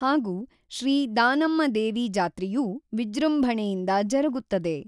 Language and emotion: Kannada, neutral